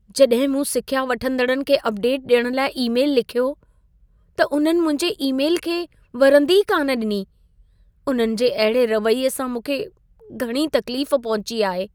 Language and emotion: Sindhi, sad